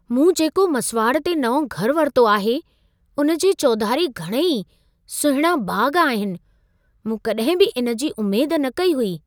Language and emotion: Sindhi, surprised